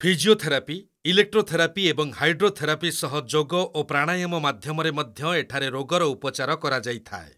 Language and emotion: Odia, neutral